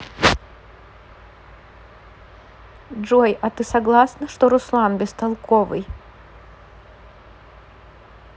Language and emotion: Russian, neutral